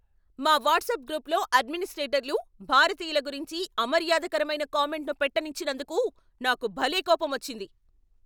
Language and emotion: Telugu, angry